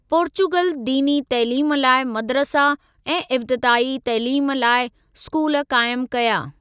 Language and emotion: Sindhi, neutral